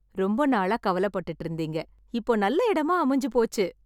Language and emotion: Tamil, happy